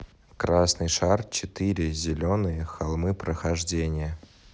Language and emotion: Russian, neutral